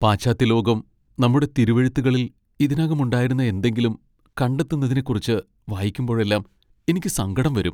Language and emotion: Malayalam, sad